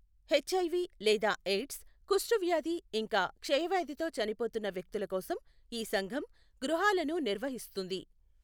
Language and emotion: Telugu, neutral